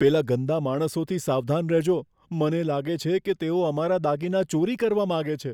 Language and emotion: Gujarati, fearful